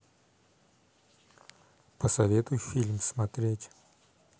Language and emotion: Russian, neutral